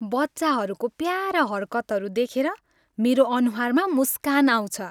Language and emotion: Nepali, happy